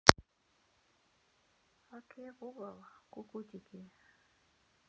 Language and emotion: Russian, neutral